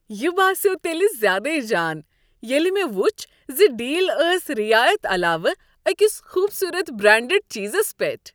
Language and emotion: Kashmiri, happy